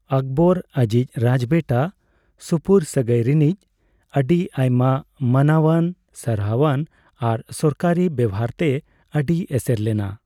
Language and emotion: Santali, neutral